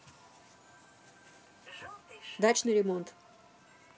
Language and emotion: Russian, neutral